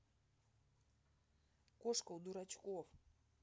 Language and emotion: Russian, sad